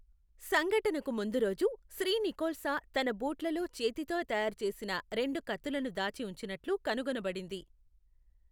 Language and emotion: Telugu, neutral